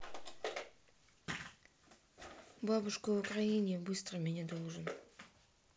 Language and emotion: Russian, sad